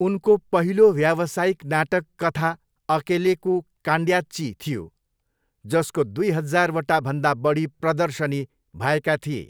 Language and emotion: Nepali, neutral